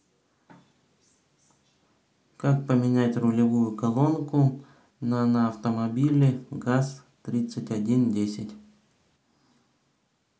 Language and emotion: Russian, neutral